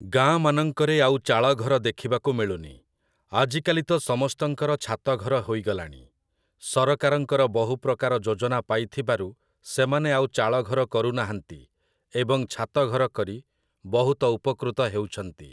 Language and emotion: Odia, neutral